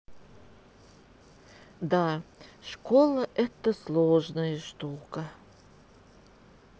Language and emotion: Russian, sad